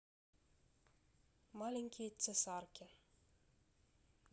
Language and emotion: Russian, neutral